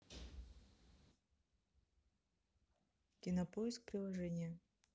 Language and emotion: Russian, neutral